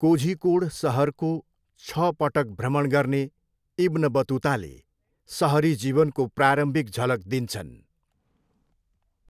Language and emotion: Nepali, neutral